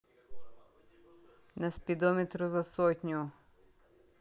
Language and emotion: Russian, neutral